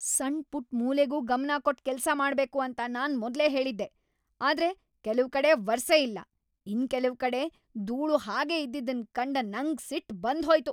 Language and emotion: Kannada, angry